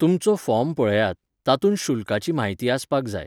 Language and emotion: Goan Konkani, neutral